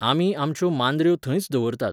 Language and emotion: Goan Konkani, neutral